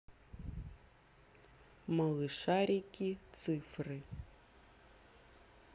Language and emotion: Russian, neutral